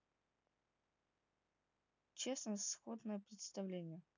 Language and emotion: Russian, neutral